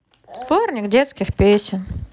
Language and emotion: Russian, neutral